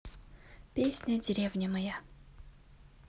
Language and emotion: Russian, neutral